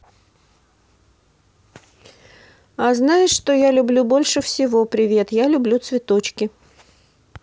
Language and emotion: Russian, neutral